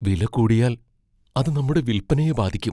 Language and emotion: Malayalam, fearful